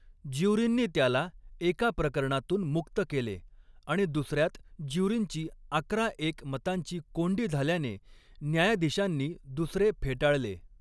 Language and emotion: Marathi, neutral